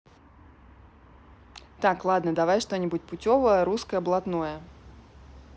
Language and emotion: Russian, neutral